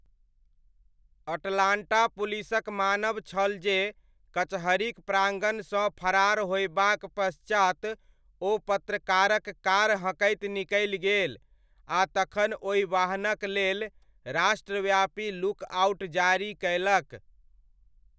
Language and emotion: Maithili, neutral